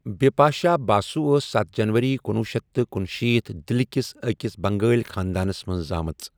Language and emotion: Kashmiri, neutral